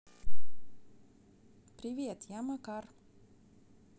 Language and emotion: Russian, neutral